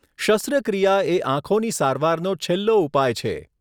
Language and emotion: Gujarati, neutral